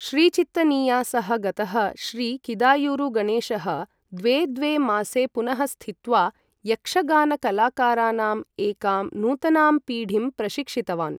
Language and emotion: Sanskrit, neutral